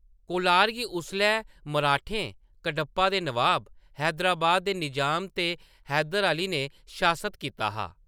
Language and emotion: Dogri, neutral